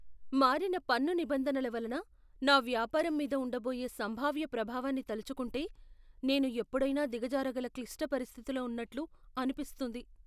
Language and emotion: Telugu, fearful